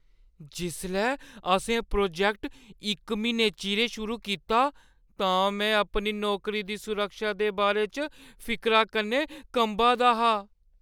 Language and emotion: Dogri, fearful